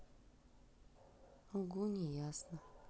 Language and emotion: Russian, sad